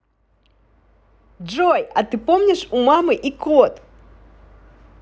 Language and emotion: Russian, positive